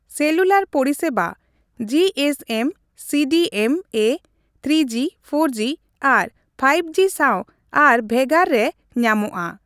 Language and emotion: Santali, neutral